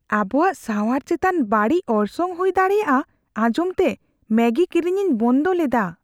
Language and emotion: Santali, fearful